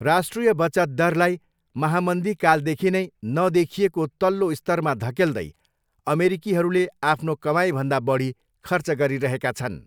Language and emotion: Nepali, neutral